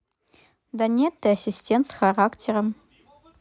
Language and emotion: Russian, neutral